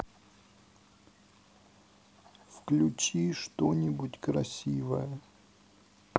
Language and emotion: Russian, sad